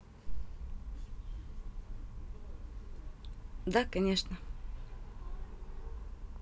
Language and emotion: Russian, neutral